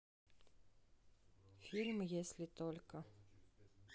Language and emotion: Russian, neutral